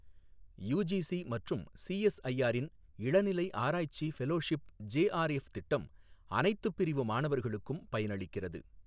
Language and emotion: Tamil, neutral